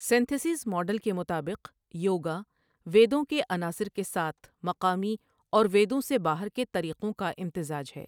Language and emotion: Urdu, neutral